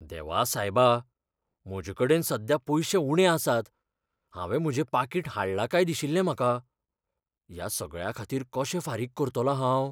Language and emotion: Goan Konkani, fearful